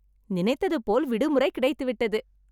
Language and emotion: Tamil, happy